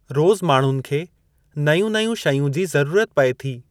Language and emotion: Sindhi, neutral